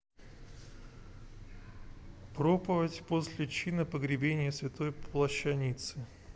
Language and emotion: Russian, neutral